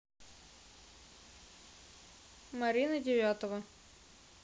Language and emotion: Russian, neutral